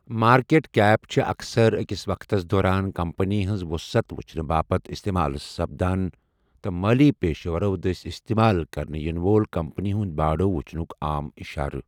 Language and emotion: Kashmiri, neutral